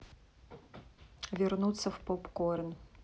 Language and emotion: Russian, neutral